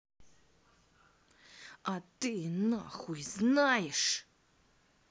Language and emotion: Russian, angry